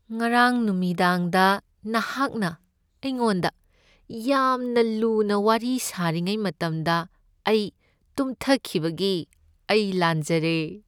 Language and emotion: Manipuri, sad